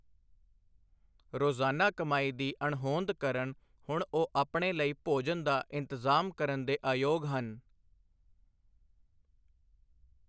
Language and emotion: Punjabi, neutral